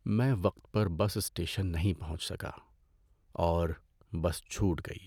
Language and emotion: Urdu, sad